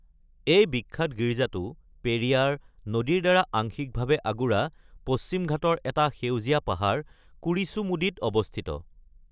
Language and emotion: Assamese, neutral